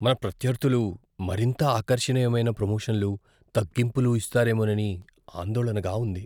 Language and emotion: Telugu, fearful